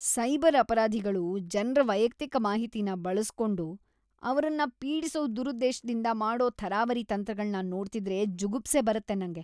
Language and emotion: Kannada, disgusted